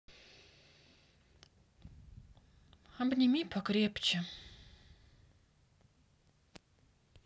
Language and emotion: Russian, sad